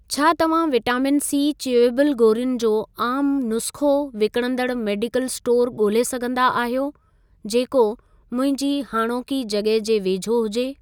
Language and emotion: Sindhi, neutral